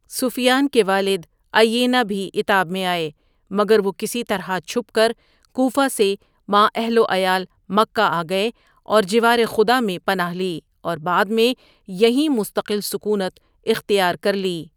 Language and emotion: Urdu, neutral